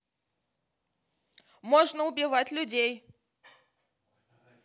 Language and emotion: Russian, neutral